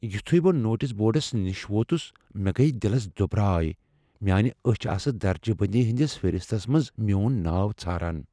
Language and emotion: Kashmiri, fearful